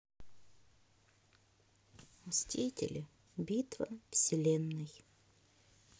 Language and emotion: Russian, neutral